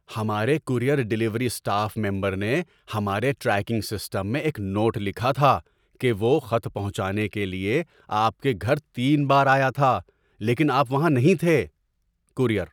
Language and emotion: Urdu, surprised